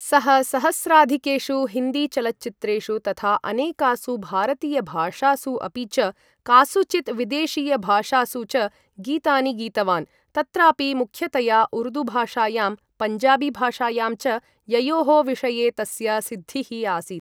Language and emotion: Sanskrit, neutral